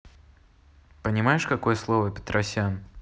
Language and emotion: Russian, neutral